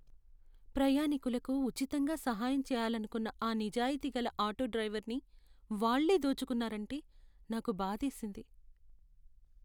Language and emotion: Telugu, sad